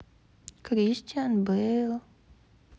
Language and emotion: Russian, sad